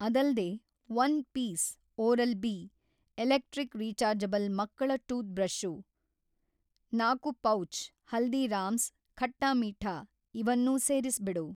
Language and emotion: Kannada, neutral